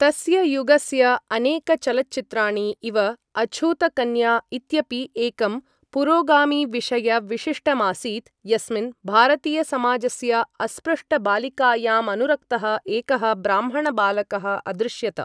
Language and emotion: Sanskrit, neutral